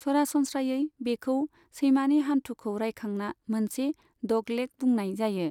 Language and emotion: Bodo, neutral